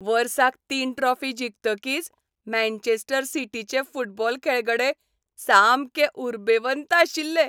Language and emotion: Goan Konkani, happy